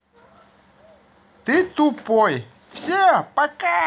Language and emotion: Russian, positive